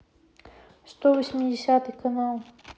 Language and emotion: Russian, neutral